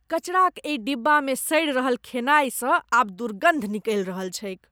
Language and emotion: Maithili, disgusted